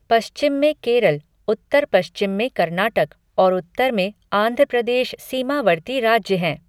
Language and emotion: Hindi, neutral